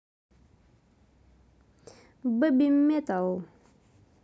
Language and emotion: Russian, positive